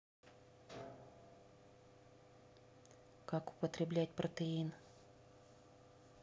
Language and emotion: Russian, neutral